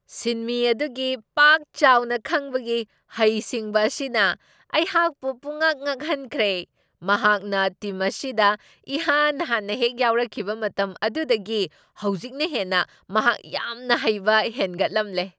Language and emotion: Manipuri, surprised